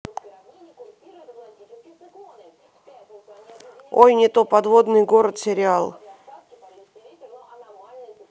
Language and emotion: Russian, neutral